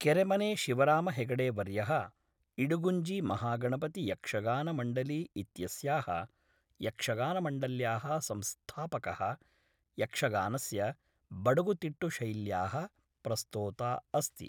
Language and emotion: Sanskrit, neutral